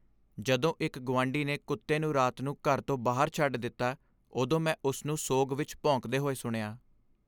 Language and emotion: Punjabi, sad